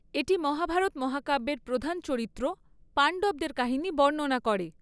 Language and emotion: Bengali, neutral